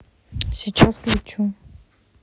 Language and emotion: Russian, neutral